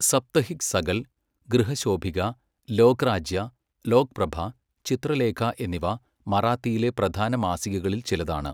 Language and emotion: Malayalam, neutral